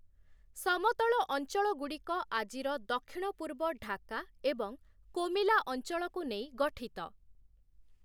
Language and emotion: Odia, neutral